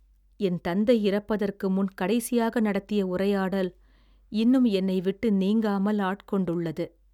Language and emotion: Tamil, sad